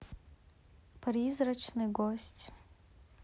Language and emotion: Russian, neutral